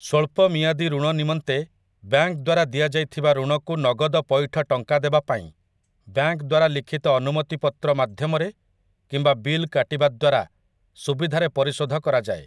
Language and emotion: Odia, neutral